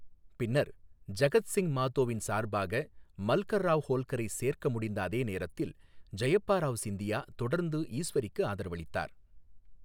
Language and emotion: Tamil, neutral